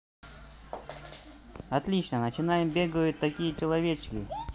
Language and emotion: Russian, positive